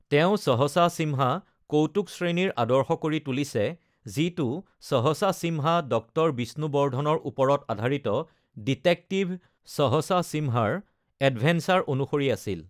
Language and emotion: Assamese, neutral